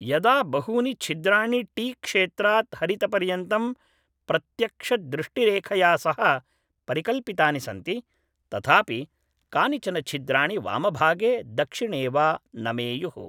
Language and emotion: Sanskrit, neutral